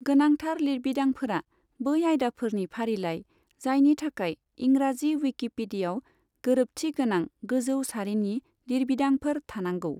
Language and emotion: Bodo, neutral